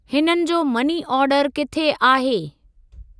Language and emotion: Sindhi, neutral